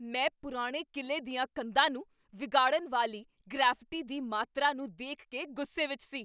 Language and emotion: Punjabi, angry